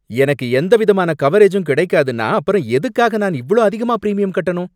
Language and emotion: Tamil, angry